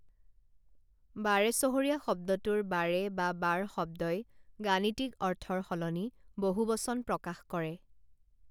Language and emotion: Assamese, neutral